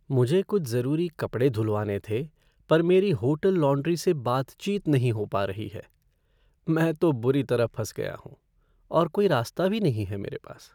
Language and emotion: Hindi, sad